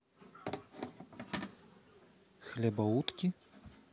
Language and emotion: Russian, neutral